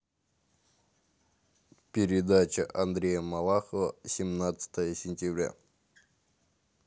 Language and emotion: Russian, neutral